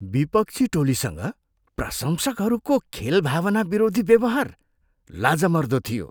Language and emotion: Nepali, disgusted